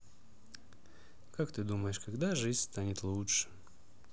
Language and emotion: Russian, sad